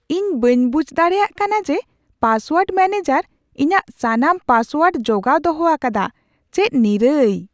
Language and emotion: Santali, surprised